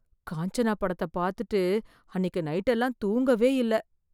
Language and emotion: Tamil, fearful